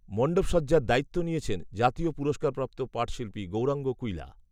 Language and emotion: Bengali, neutral